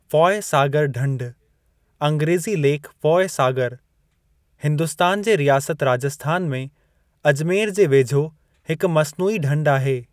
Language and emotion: Sindhi, neutral